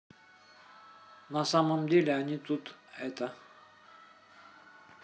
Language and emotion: Russian, neutral